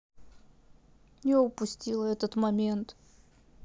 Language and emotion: Russian, sad